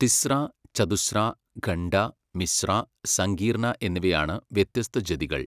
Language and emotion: Malayalam, neutral